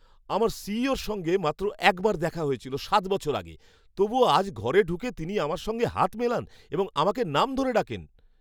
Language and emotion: Bengali, surprised